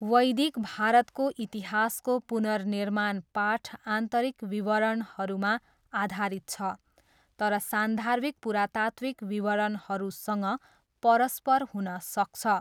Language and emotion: Nepali, neutral